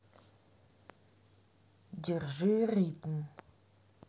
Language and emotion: Russian, neutral